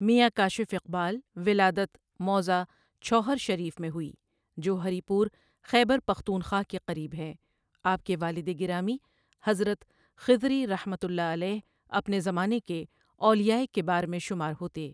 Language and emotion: Urdu, neutral